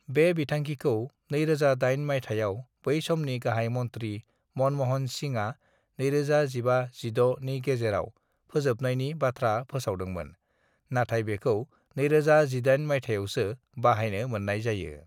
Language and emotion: Bodo, neutral